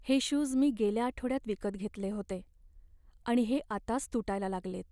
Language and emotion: Marathi, sad